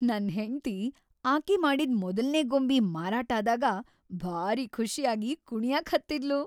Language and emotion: Kannada, happy